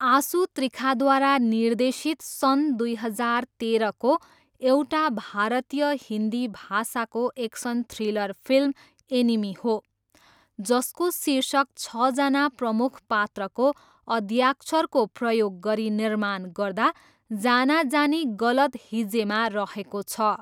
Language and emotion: Nepali, neutral